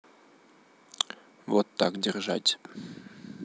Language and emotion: Russian, neutral